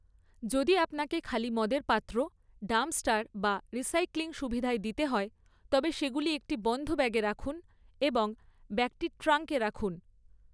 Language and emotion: Bengali, neutral